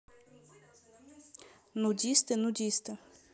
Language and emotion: Russian, neutral